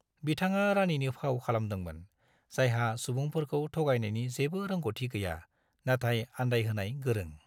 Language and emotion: Bodo, neutral